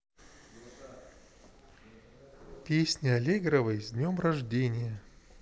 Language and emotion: Russian, neutral